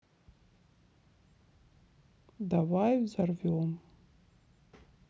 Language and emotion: Russian, sad